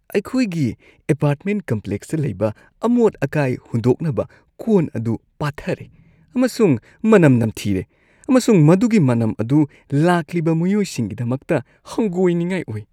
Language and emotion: Manipuri, disgusted